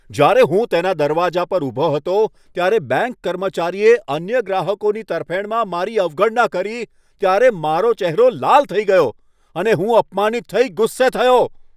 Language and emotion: Gujarati, angry